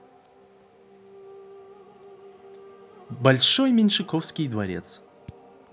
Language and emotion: Russian, positive